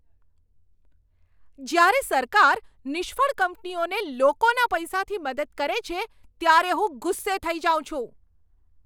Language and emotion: Gujarati, angry